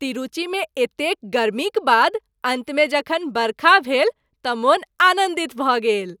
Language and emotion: Maithili, happy